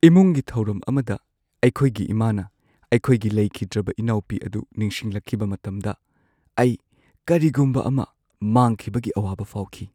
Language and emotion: Manipuri, sad